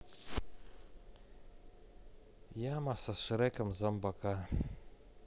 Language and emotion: Russian, sad